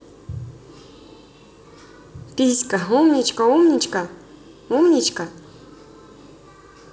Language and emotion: Russian, positive